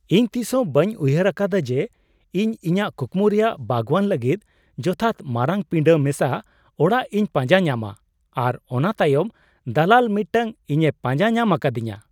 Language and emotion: Santali, surprised